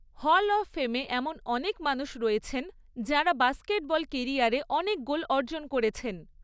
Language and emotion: Bengali, neutral